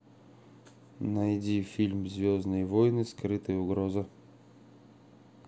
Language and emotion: Russian, neutral